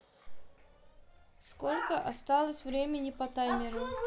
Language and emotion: Russian, neutral